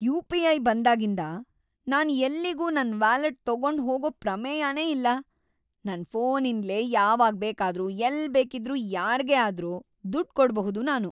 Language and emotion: Kannada, happy